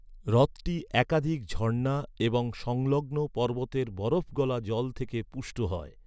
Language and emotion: Bengali, neutral